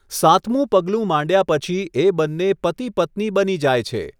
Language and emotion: Gujarati, neutral